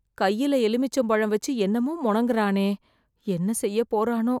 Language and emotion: Tamil, fearful